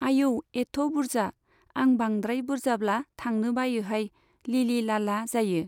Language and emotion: Bodo, neutral